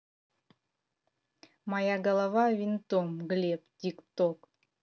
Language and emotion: Russian, neutral